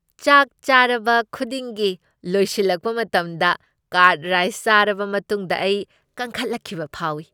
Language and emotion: Manipuri, happy